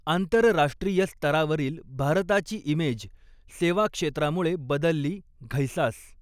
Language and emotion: Marathi, neutral